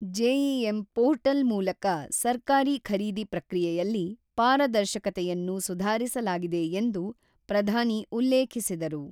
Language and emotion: Kannada, neutral